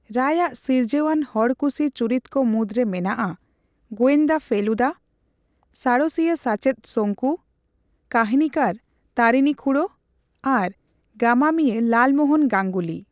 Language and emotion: Santali, neutral